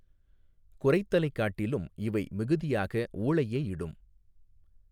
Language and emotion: Tamil, neutral